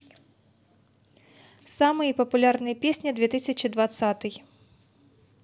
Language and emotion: Russian, positive